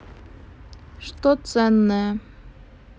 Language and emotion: Russian, neutral